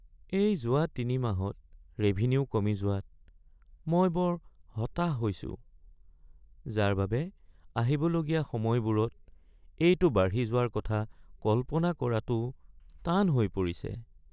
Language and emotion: Assamese, sad